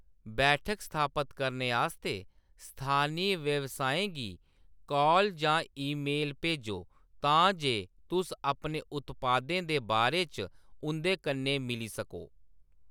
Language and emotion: Dogri, neutral